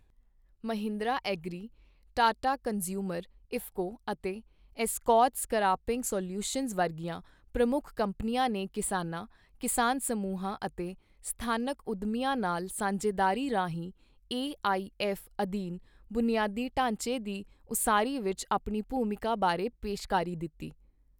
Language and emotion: Punjabi, neutral